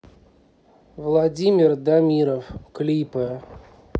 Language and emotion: Russian, neutral